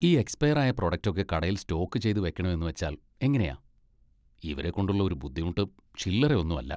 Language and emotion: Malayalam, disgusted